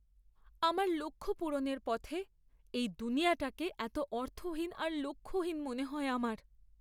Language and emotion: Bengali, sad